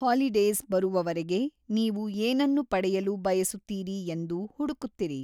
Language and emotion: Kannada, neutral